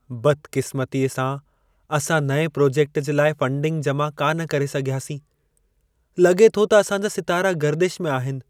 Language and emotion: Sindhi, sad